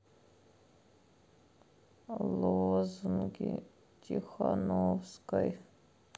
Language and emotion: Russian, sad